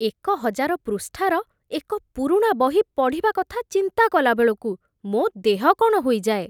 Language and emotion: Odia, disgusted